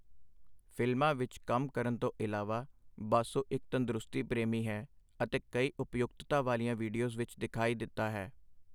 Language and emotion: Punjabi, neutral